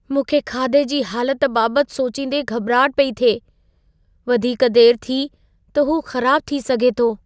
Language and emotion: Sindhi, fearful